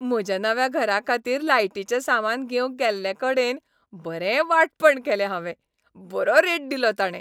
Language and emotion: Goan Konkani, happy